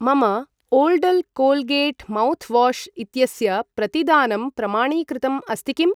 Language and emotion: Sanskrit, neutral